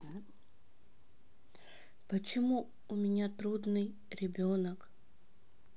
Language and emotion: Russian, sad